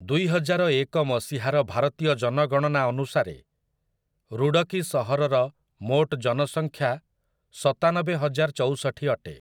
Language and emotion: Odia, neutral